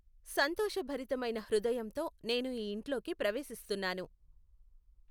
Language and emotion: Telugu, neutral